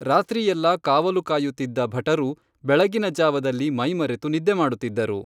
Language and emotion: Kannada, neutral